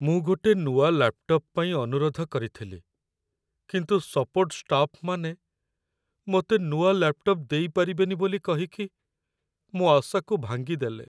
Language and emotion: Odia, sad